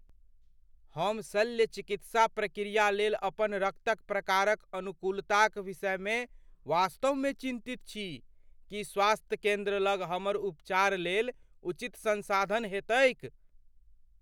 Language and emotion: Maithili, fearful